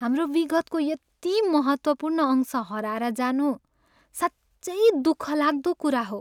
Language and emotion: Nepali, sad